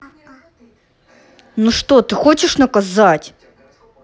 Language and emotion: Russian, angry